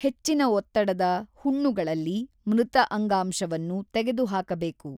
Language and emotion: Kannada, neutral